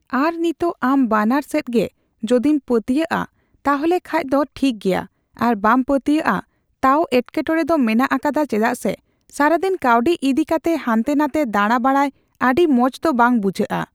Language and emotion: Santali, neutral